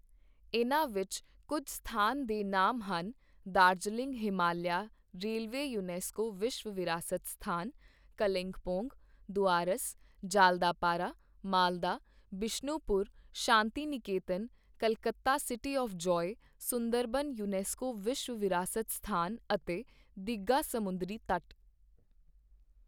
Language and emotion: Punjabi, neutral